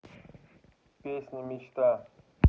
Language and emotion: Russian, neutral